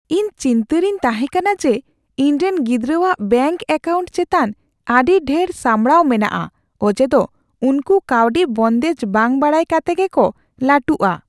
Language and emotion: Santali, fearful